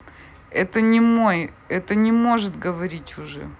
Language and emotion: Russian, neutral